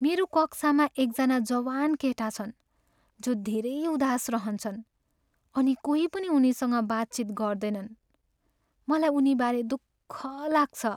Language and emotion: Nepali, sad